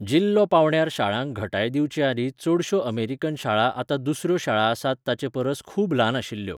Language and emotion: Goan Konkani, neutral